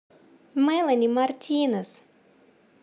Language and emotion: Russian, positive